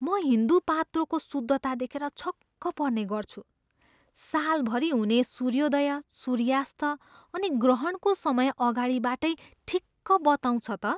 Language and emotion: Nepali, surprised